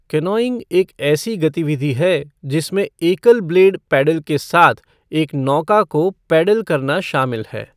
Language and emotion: Hindi, neutral